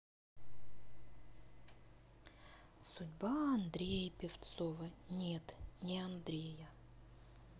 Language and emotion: Russian, sad